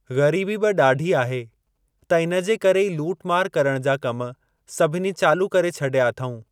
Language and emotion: Sindhi, neutral